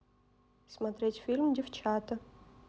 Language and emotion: Russian, neutral